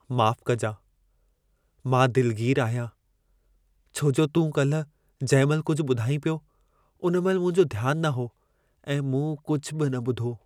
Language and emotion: Sindhi, sad